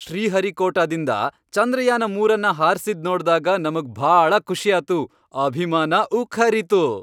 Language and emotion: Kannada, happy